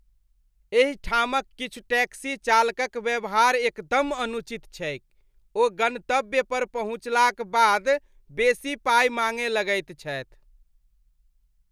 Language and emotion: Maithili, disgusted